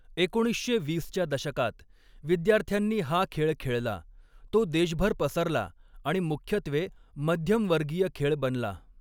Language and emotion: Marathi, neutral